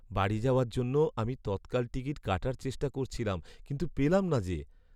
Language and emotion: Bengali, sad